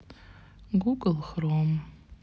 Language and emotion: Russian, sad